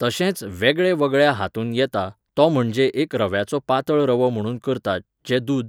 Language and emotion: Goan Konkani, neutral